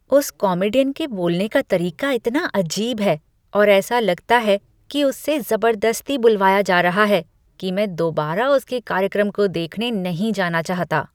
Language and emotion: Hindi, disgusted